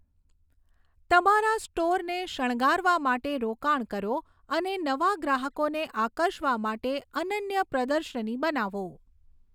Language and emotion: Gujarati, neutral